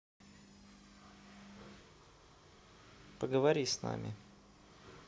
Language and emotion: Russian, neutral